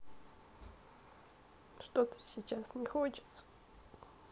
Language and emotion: Russian, sad